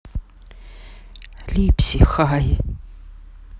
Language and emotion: Russian, neutral